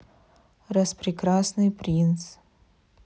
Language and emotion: Russian, neutral